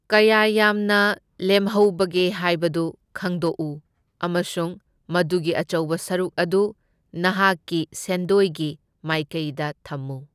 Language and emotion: Manipuri, neutral